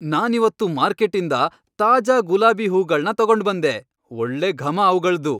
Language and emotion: Kannada, happy